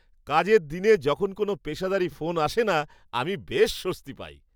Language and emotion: Bengali, happy